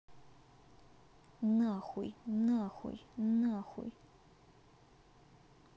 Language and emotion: Russian, angry